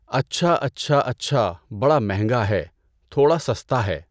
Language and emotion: Urdu, neutral